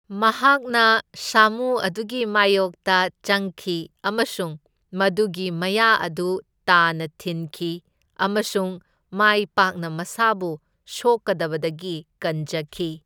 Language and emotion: Manipuri, neutral